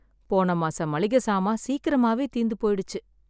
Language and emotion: Tamil, sad